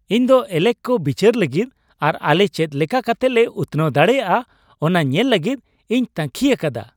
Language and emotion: Santali, happy